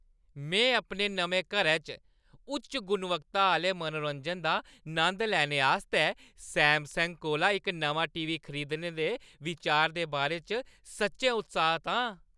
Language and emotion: Dogri, happy